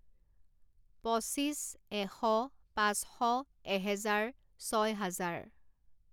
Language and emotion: Assamese, neutral